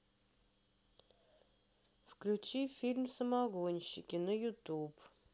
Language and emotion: Russian, neutral